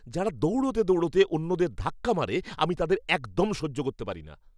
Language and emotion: Bengali, angry